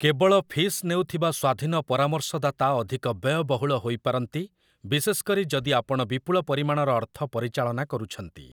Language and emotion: Odia, neutral